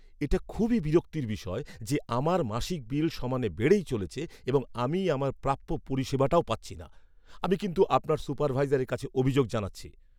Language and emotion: Bengali, angry